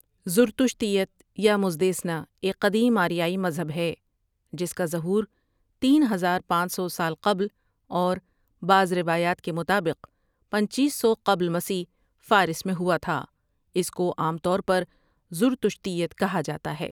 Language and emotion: Urdu, neutral